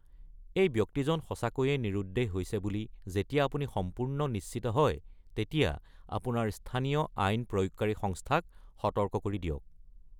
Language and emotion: Assamese, neutral